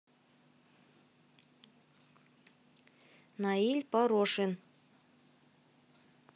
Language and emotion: Russian, neutral